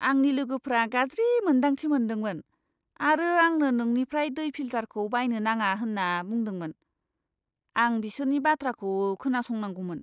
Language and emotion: Bodo, disgusted